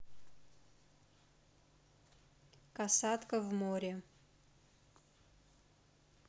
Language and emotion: Russian, neutral